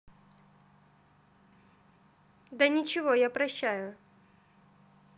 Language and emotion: Russian, neutral